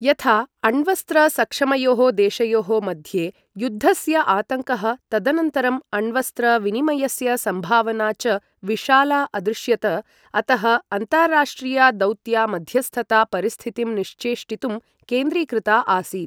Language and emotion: Sanskrit, neutral